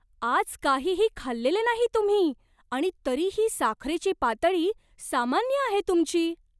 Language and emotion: Marathi, surprised